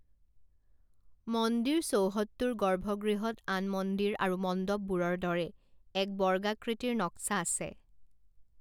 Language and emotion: Assamese, neutral